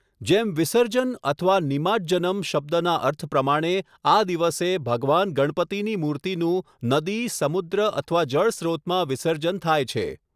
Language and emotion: Gujarati, neutral